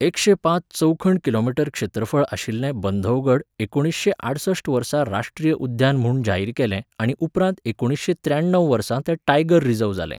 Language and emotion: Goan Konkani, neutral